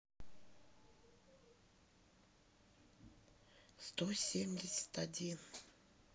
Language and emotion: Russian, neutral